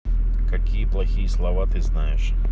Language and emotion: Russian, neutral